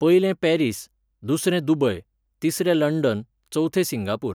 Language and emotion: Goan Konkani, neutral